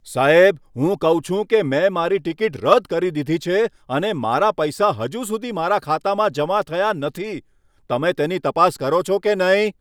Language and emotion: Gujarati, angry